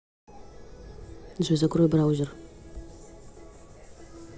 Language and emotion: Russian, neutral